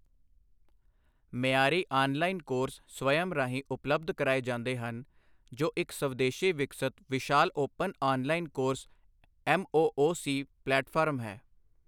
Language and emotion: Punjabi, neutral